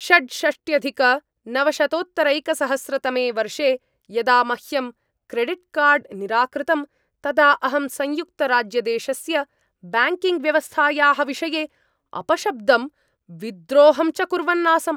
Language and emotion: Sanskrit, angry